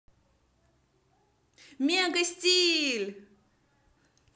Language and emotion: Russian, positive